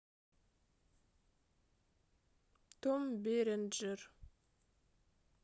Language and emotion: Russian, neutral